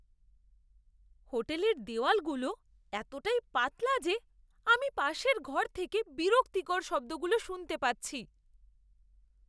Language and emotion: Bengali, disgusted